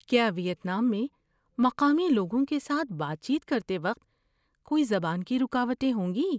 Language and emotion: Urdu, fearful